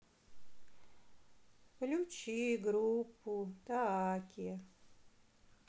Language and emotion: Russian, sad